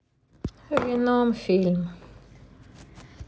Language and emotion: Russian, sad